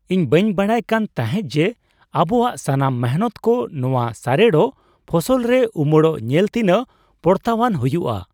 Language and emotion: Santali, surprised